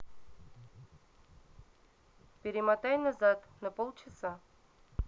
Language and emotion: Russian, neutral